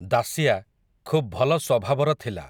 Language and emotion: Odia, neutral